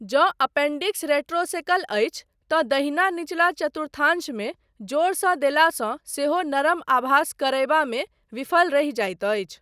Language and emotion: Maithili, neutral